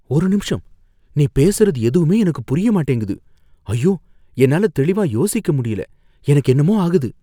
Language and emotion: Tamil, fearful